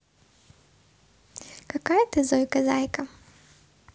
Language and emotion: Russian, positive